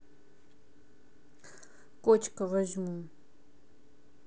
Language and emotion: Russian, neutral